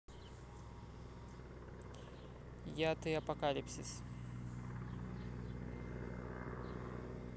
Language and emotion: Russian, neutral